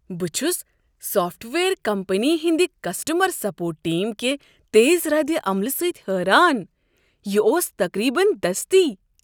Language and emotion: Kashmiri, surprised